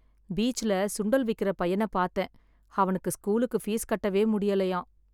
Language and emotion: Tamil, sad